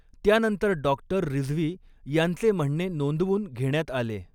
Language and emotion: Marathi, neutral